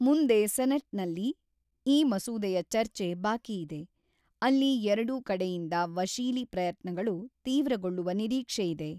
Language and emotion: Kannada, neutral